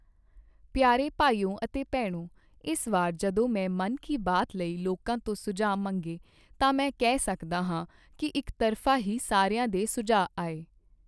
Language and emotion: Punjabi, neutral